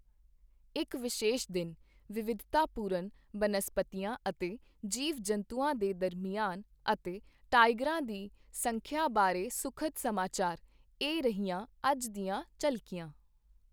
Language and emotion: Punjabi, neutral